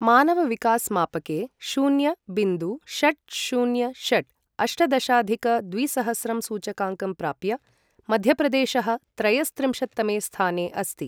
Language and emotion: Sanskrit, neutral